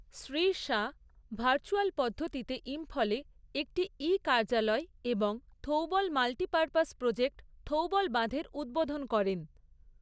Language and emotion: Bengali, neutral